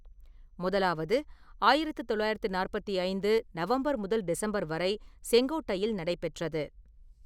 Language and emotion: Tamil, neutral